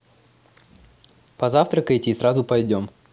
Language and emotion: Russian, positive